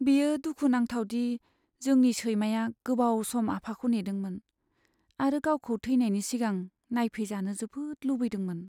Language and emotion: Bodo, sad